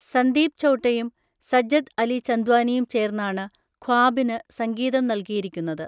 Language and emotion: Malayalam, neutral